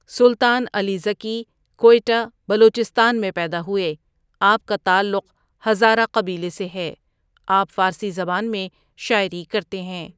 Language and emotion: Urdu, neutral